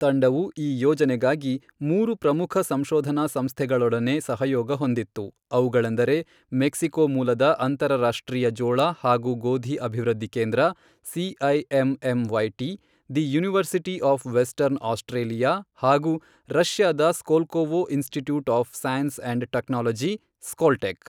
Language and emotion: Kannada, neutral